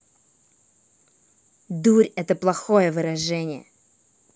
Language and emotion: Russian, angry